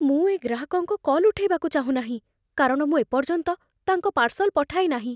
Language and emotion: Odia, fearful